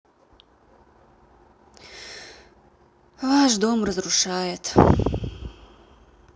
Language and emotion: Russian, sad